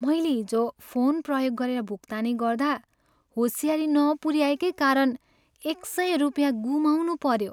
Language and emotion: Nepali, sad